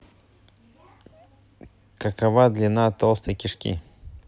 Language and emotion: Russian, neutral